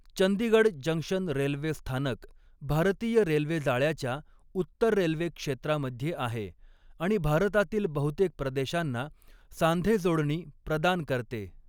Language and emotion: Marathi, neutral